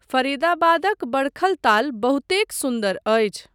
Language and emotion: Maithili, neutral